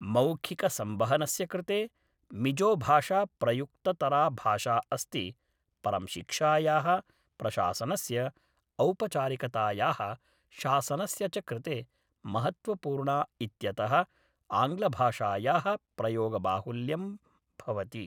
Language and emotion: Sanskrit, neutral